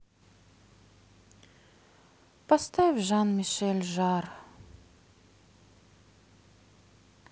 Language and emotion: Russian, sad